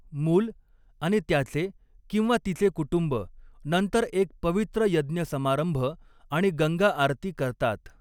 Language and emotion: Marathi, neutral